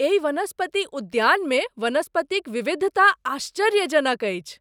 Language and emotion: Maithili, surprised